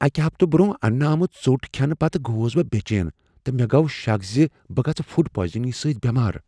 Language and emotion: Kashmiri, fearful